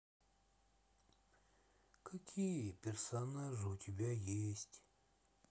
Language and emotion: Russian, sad